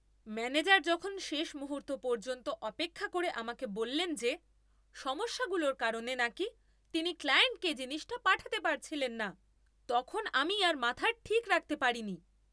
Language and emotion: Bengali, angry